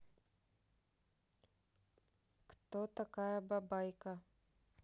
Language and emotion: Russian, neutral